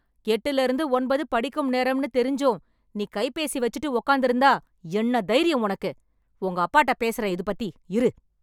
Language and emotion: Tamil, angry